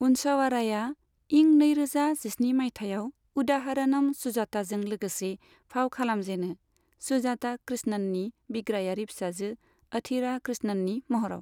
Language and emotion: Bodo, neutral